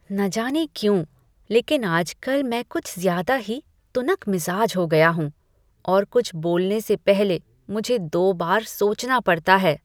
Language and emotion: Hindi, disgusted